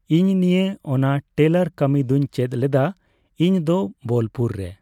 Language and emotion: Santali, neutral